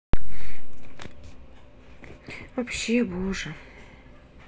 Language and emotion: Russian, sad